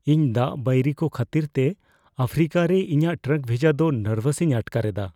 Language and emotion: Santali, fearful